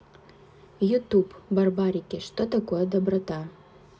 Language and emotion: Russian, neutral